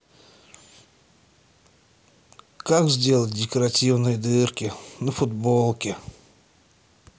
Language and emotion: Russian, sad